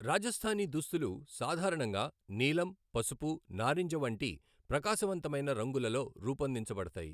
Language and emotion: Telugu, neutral